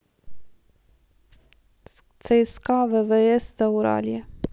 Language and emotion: Russian, neutral